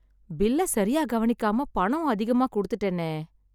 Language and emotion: Tamil, sad